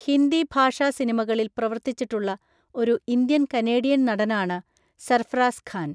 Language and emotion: Malayalam, neutral